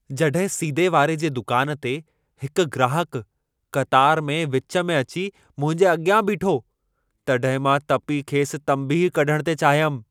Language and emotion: Sindhi, angry